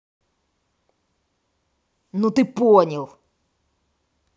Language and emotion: Russian, angry